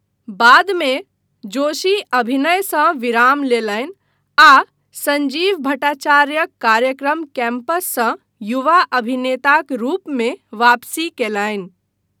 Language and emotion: Maithili, neutral